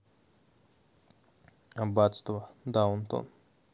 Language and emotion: Russian, neutral